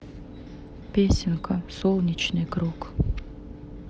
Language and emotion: Russian, neutral